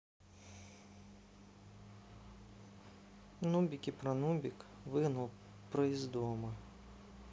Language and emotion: Russian, neutral